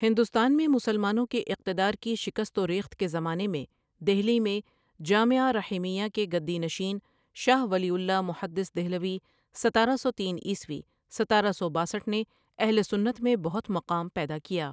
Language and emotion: Urdu, neutral